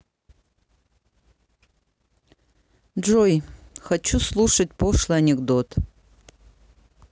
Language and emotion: Russian, neutral